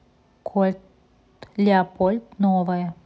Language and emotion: Russian, neutral